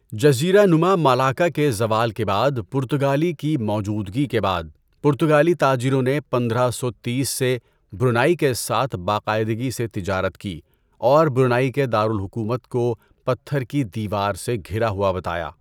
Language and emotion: Urdu, neutral